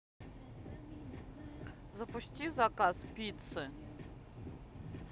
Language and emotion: Russian, neutral